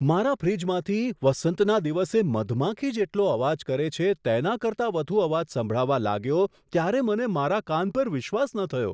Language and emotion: Gujarati, surprised